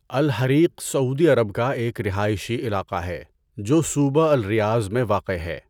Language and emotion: Urdu, neutral